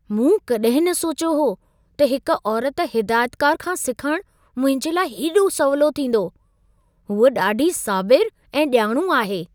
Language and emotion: Sindhi, surprised